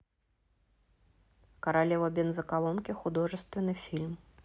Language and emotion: Russian, neutral